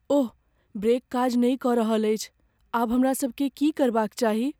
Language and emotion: Maithili, fearful